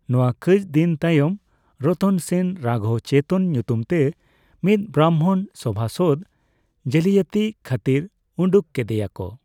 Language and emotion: Santali, neutral